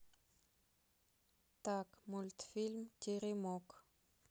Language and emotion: Russian, neutral